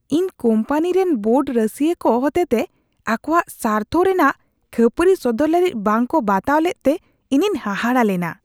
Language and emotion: Santali, disgusted